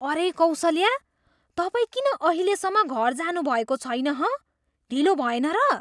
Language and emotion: Nepali, surprised